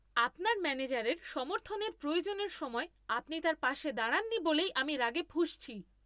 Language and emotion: Bengali, angry